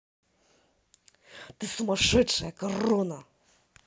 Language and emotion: Russian, angry